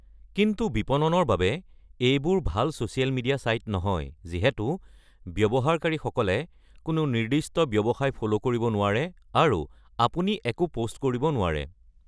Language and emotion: Assamese, neutral